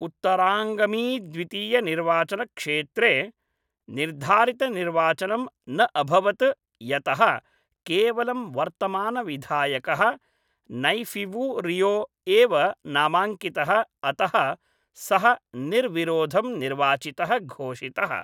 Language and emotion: Sanskrit, neutral